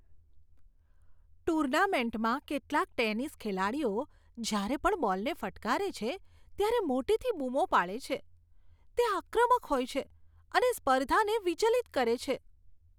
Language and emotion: Gujarati, disgusted